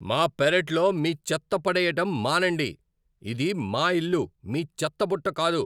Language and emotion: Telugu, angry